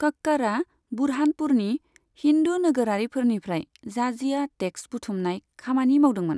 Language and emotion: Bodo, neutral